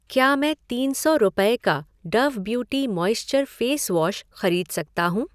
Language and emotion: Hindi, neutral